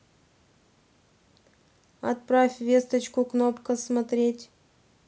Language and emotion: Russian, neutral